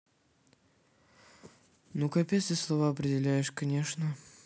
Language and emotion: Russian, sad